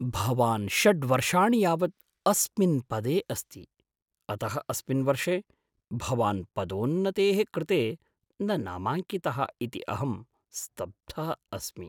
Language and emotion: Sanskrit, surprised